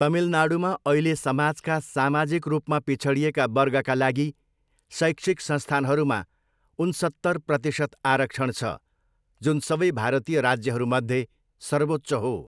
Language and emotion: Nepali, neutral